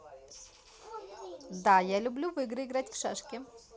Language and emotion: Russian, positive